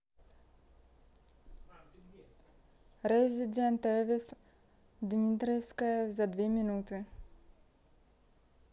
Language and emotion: Russian, neutral